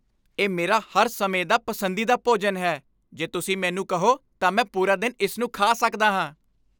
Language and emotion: Punjabi, happy